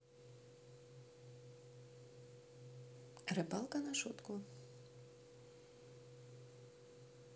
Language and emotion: Russian, neutral